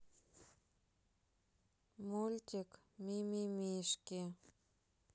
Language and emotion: Russian, sad